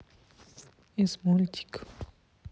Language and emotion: Russian, sad